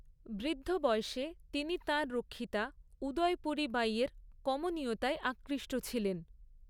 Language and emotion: Bengali, neutral